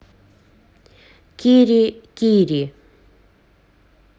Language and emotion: Russian, neutral